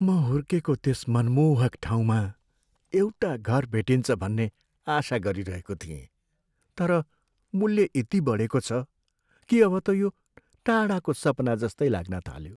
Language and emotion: Nepali, sad